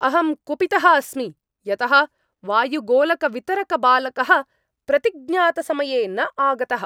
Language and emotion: Sanskrit, angry